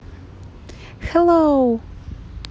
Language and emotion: Russian, positive